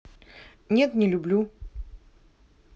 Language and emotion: Russian, neutral